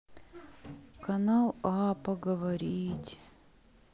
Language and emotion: Russian, sad